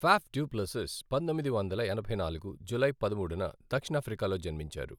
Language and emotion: Telugu, neutral